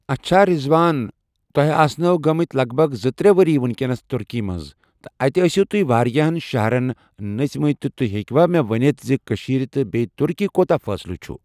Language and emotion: Kashmiri, neutral